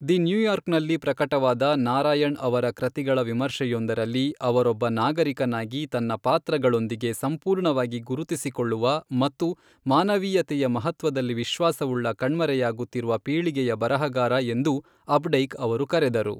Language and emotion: Kannada, neutral